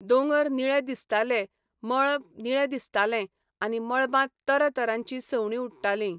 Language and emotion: Goan Konkani, neutral